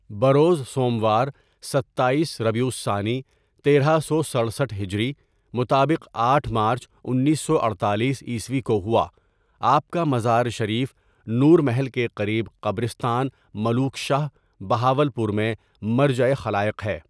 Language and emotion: Urdu, neutral